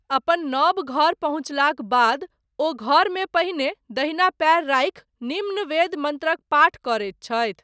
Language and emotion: Maithili, neutral